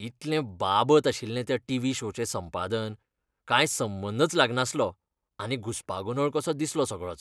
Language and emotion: Goan Konkani, disgusted